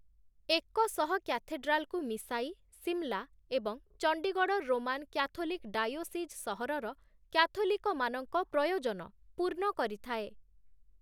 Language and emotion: Odia, neutral